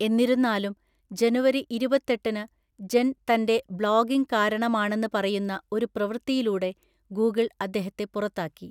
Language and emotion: Malayalam, neutral